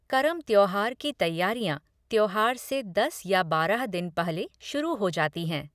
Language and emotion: Hindi, neutral